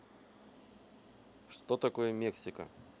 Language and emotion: Russian, neutral